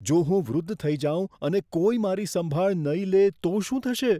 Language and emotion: Gujarati, fearful